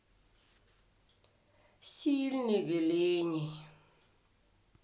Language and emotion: Russian, sad